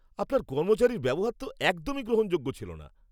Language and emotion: Bengali, angry